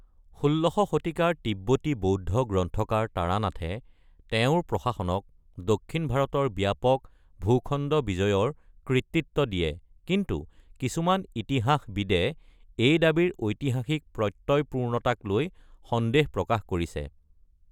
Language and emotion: Assamese, neutral